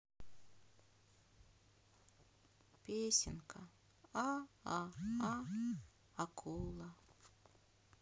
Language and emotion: Russian, sad